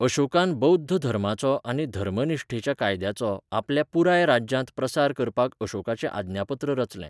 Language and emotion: Goan Konkani, neutral